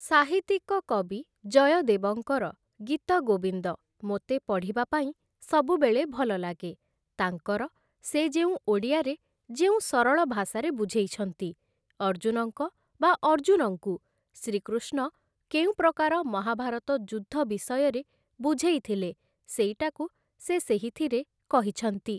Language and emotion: Odia, neutral